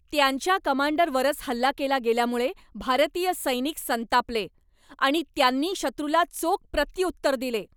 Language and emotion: Marathi, angry